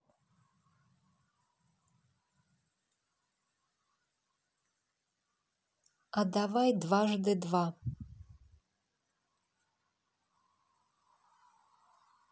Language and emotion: Russian, neutral